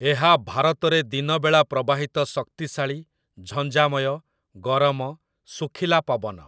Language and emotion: Odia, neutral